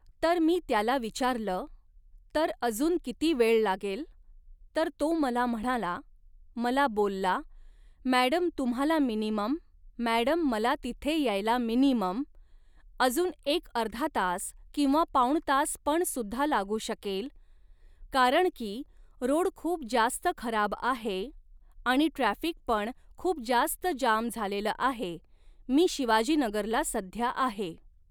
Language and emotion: Marathi, neutral